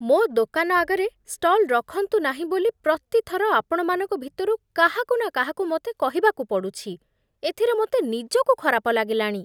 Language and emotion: Odia, disgusted